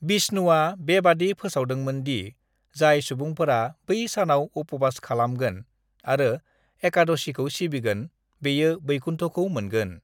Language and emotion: Bodo, neutral